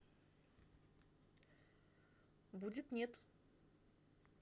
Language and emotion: Russian, neutral